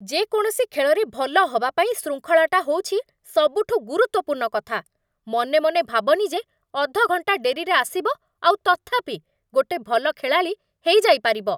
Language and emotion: Odia, angry